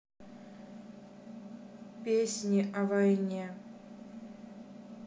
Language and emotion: Russian, sad